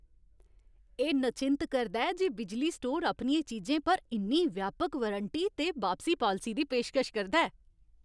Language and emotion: Dogri, happy